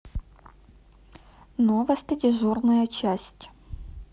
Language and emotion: Russian, neutral